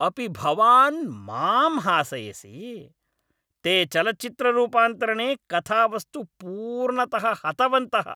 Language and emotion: Sanskrit, angry